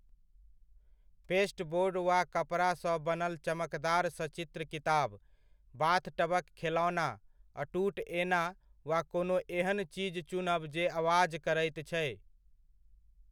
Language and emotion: Maithili, neutral